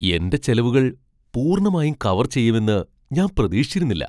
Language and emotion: Malayalam, surprised